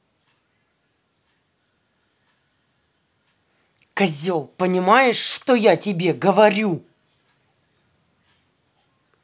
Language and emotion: Russian, angry